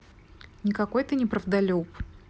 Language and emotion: Russian, neutral